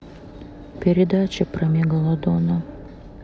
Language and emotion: Russian, sad